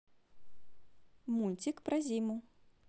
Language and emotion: Russian, positive